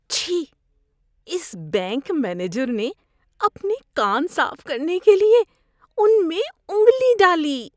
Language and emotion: Urdu, disgusted